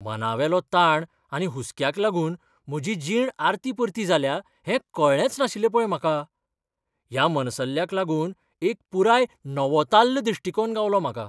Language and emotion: Goan Konkani, surprised